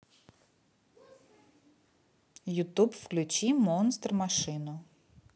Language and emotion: Russian, neutral